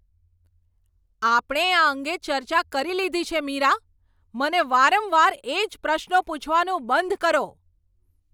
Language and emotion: Gujarati, angry